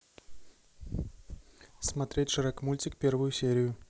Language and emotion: Russian, neutral